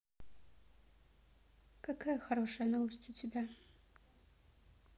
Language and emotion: Russian, sad